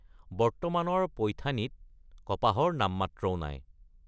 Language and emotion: Assamese, neutral